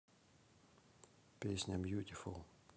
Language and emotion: Russian, neutral